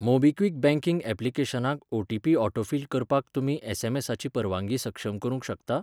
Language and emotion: Goan Konkani, neutral